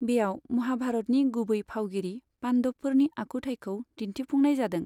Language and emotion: Bodo, neutral